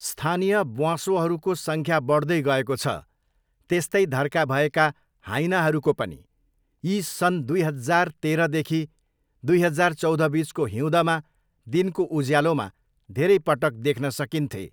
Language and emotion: Nepali, neutral